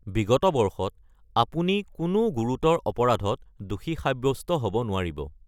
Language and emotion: Assamese, neutral